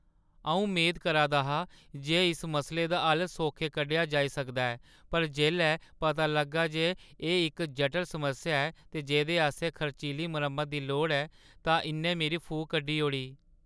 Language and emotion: Dogri, sad